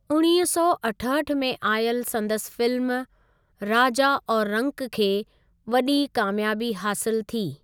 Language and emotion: Sindhi, neutral